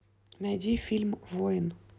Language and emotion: Russian, neutral